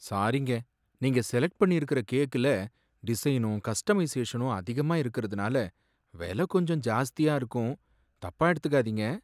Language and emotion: Tamil, sad